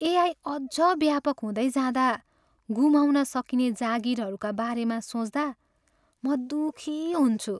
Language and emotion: Nepali, sad